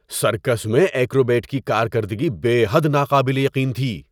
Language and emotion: Urdu, surprised